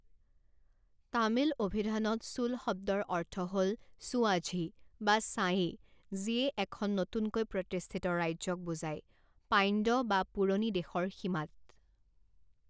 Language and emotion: Assamese, neutral